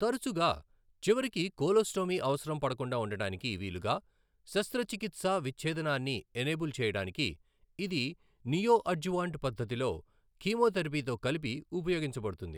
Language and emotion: Telugu, neutral